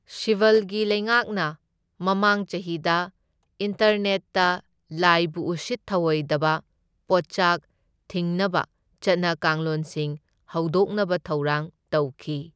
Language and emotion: Manipuri, neutral